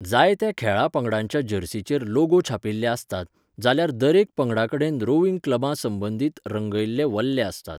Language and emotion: Goan Konkani, neutral